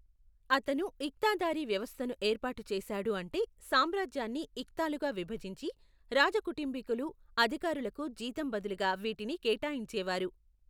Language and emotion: Telugu, neutral